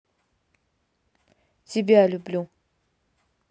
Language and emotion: Russian, neutral